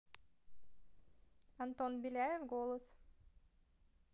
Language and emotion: Russian, neutral